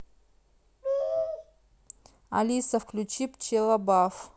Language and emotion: Russian, neutral